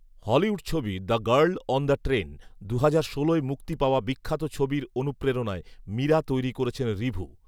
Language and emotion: Bengali, neutral